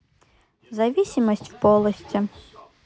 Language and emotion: Russian, neutral